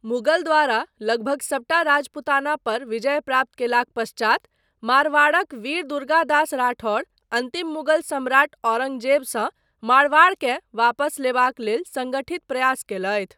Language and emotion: Maithili, neutral